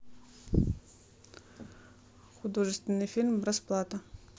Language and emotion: Russian, neutral